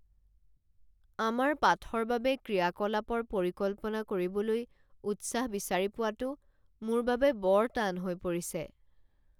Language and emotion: Assamese, sad